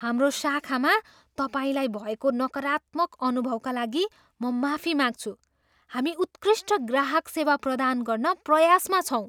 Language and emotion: Nepali, surprised